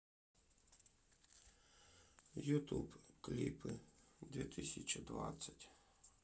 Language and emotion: Russian, neutral